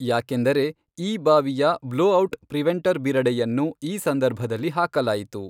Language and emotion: Kannada, neutral